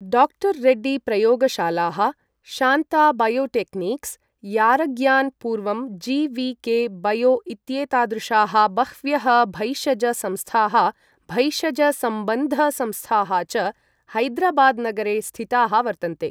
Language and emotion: Sanskrit, neutral